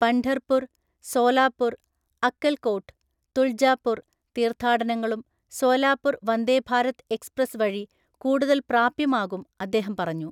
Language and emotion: Malayalam, neutral